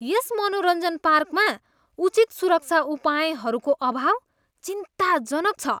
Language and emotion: Nepali, disgusted